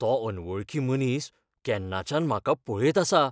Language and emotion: Goan Konkani, fearful